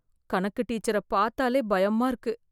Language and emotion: Tamil, fearful